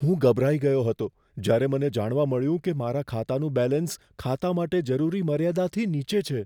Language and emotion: Gujarati, fearful